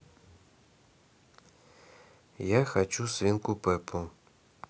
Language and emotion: Russian, neutral